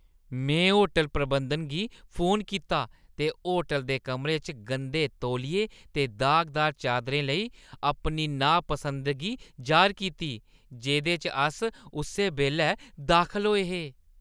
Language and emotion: Dogri, disgusted